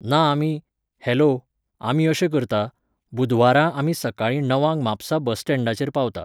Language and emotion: Goan Konkani, neutral